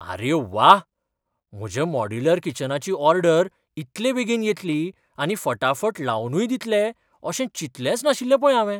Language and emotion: Goan Konkani, surprised